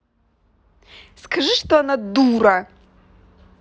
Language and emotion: Russian, angry